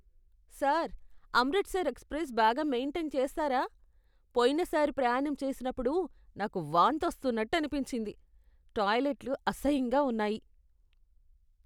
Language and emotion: Telugu, disgusted